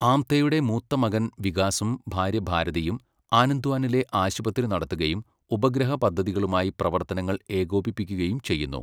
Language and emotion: Malayalam, neutral